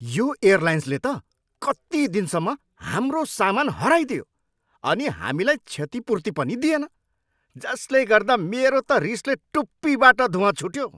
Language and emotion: Nepali, angry